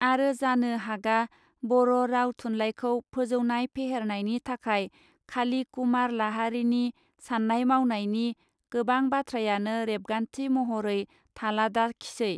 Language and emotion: Bodo, neutral